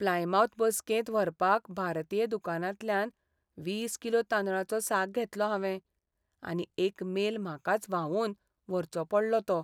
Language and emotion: Goan Konkani, sad